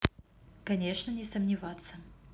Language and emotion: Russian, neutral